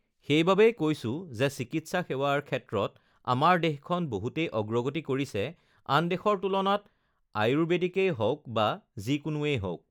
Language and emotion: Assamese, neutral